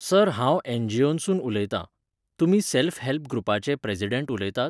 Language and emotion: Goan Konkani, neutral